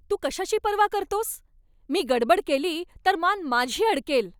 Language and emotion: Marathi, angry